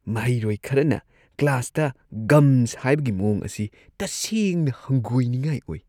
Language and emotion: Manipuri, disgusted